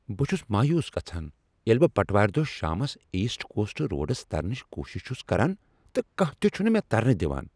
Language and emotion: Kashmiri, angry